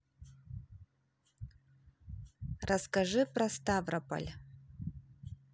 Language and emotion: Russian, neutral